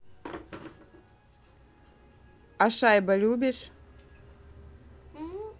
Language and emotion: Russian, neutral